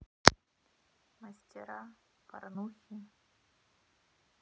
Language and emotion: Russian, sad